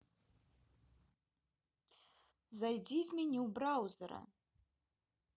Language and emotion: Russian, neutral